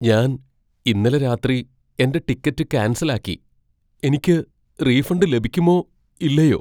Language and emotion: Malayalam, fearful